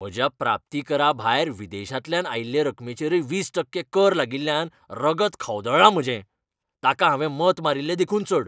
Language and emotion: Goan Konkani, angry